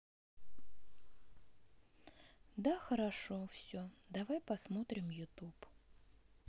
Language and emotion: Russian, sad